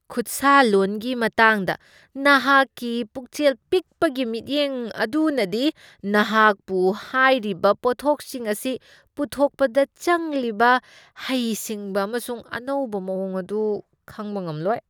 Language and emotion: Manipuri, disgusted